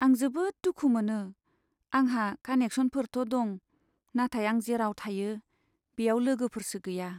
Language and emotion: Bodo, sad